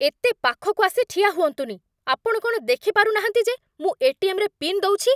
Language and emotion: Odia, angry